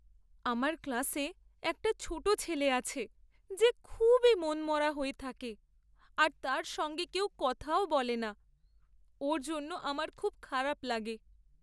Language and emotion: Bengali, sad